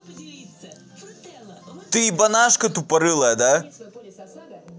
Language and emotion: Russian, angry